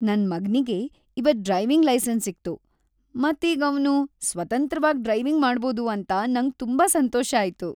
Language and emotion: Kannada, happy